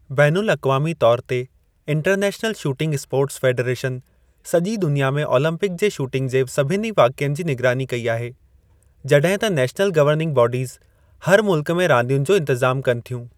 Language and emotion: Sindhi, neutral